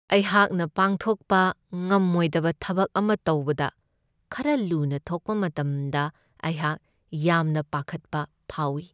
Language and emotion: Manipuri, sad